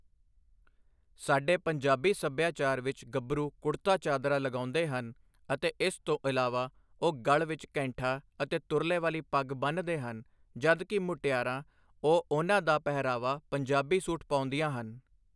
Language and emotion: Punjabi, neutral